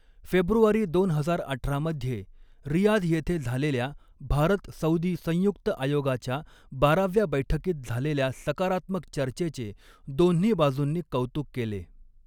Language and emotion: Marathi, neutral